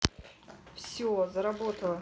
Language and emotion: Russian, neutral